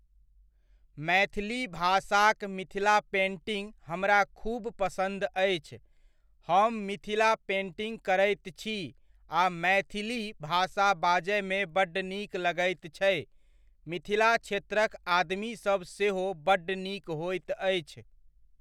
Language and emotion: Maithili, neutral